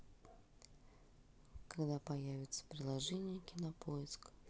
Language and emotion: Russian, neutral